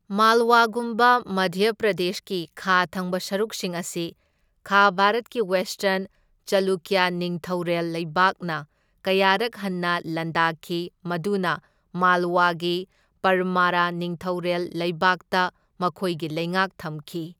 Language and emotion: Manipuri, neutral